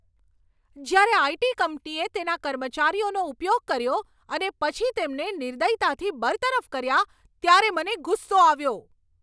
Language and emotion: Gujarati, angry